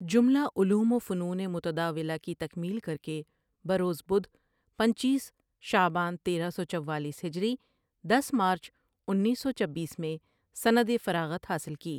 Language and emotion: Urdu, neutral